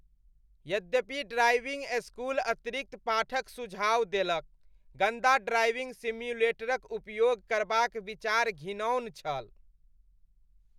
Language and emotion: Maithili, disgusted